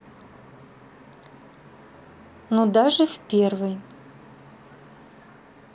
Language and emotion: Russian, neutral